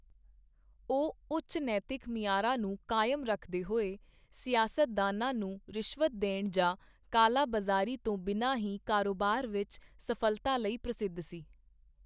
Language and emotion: Punjabi, neutral